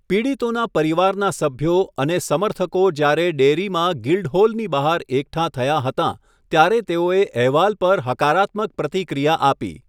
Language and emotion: Gujarati, neutral